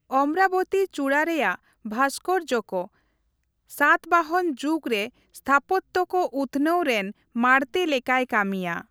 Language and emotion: Santali, neutral